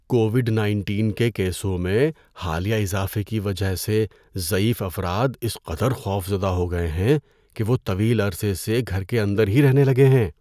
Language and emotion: Urdu, fearful